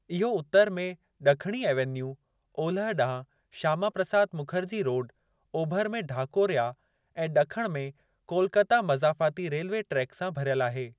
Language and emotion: Sindhi, neutral